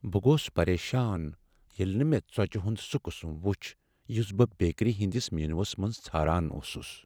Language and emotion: Kashmiri, sad